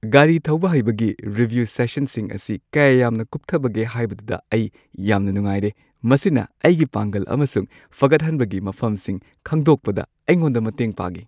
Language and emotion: Manipuri, happy